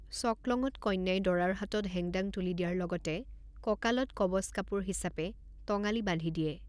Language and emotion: Assamese, neutral